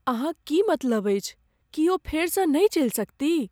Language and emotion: Maithili, fearful